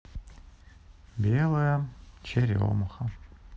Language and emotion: Russian, sad